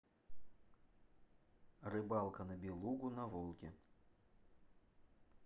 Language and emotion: Russian, neutral